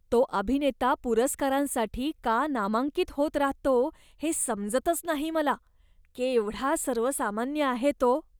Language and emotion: Marathi, disgusted